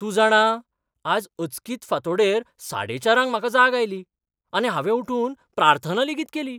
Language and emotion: Goan Konkani, surprised